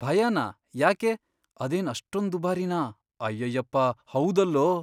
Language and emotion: Kannada, fearful